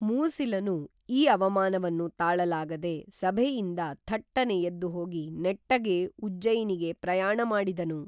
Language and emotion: Kannada, neutral